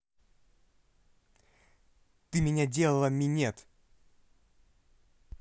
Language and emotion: Russian, angry